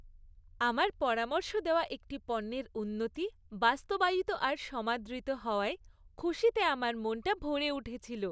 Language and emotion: Bengali, happy